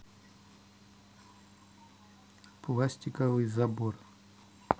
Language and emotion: Russian, neutral